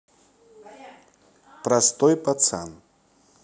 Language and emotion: Russian, neutral